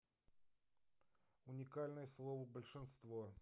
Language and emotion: Russian, neutral